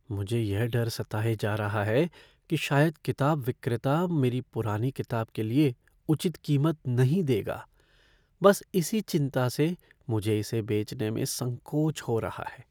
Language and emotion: Hindi, fearful